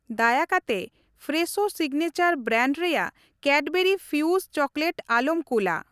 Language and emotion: Santali, neutral